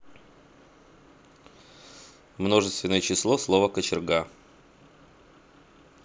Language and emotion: Russian, neutral